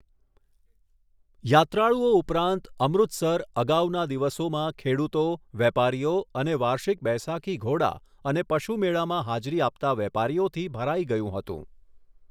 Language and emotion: Gujarati, neutral